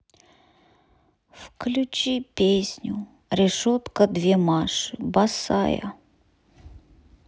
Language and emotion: Russian, sad